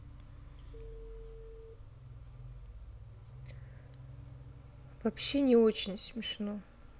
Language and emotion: Russian, sad